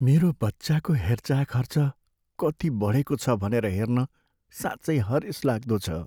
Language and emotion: Nepali, sad